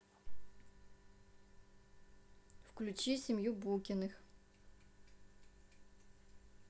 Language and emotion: Russian, neutral